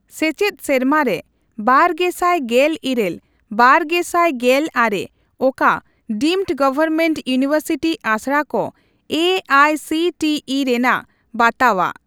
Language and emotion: Santali, neutral